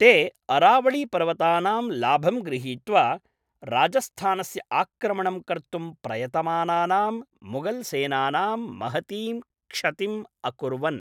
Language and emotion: Sanskrit, neutral